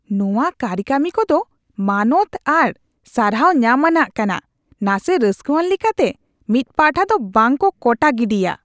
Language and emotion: Santali, disgusted